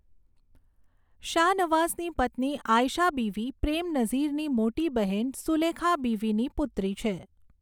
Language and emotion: Gujarati, neutral